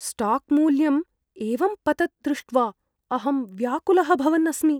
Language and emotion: Sanskrit, fearful